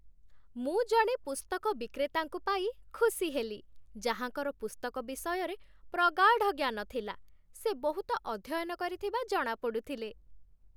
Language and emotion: Odia, happy